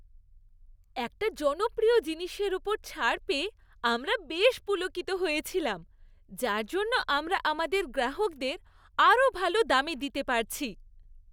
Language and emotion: Bengali, happy